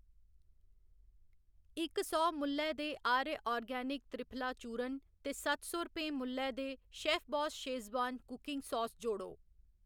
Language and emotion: Dogri, neutral